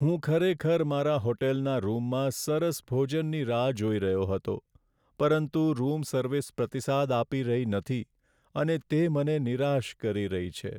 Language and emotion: Gujarati, sad